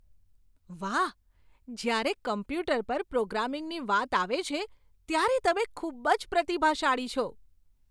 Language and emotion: Gujarati, surprised